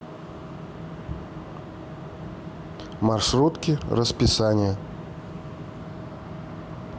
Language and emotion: Russian, neutral